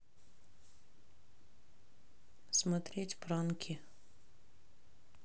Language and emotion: Russian, neutral